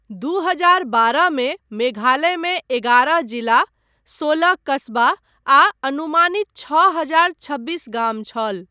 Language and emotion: Maithili, neutral